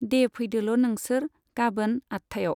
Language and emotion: Bodo, neutral